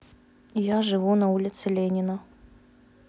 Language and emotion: Russian, neutral